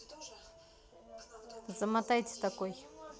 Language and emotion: Russian, neutral